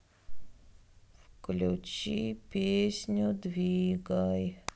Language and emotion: Russian, sad